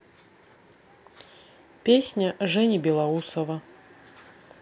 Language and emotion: Russian, neutral